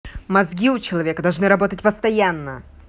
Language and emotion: Russian, angry